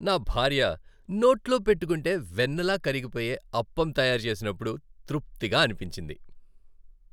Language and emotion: Telugu, happy